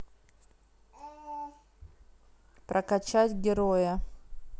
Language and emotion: Russian, neutral